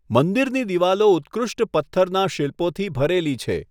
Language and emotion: Gujarati, neutral